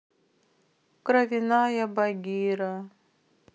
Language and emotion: Russian, sad